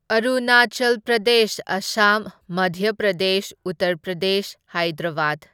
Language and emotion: Manipuri, neutral